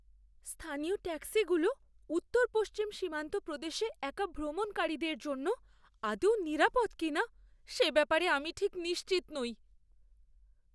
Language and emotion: Bengali, fearful